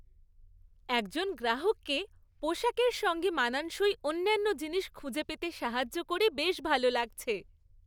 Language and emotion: Bengali, happy